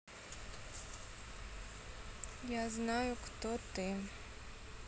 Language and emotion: Russian, neutral